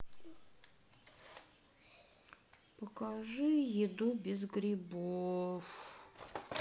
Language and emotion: Russian, sad